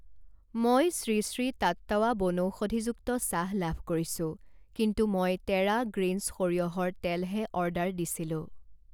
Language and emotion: Assamese, neutral